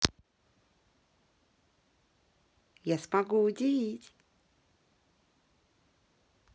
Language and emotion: Russian, positive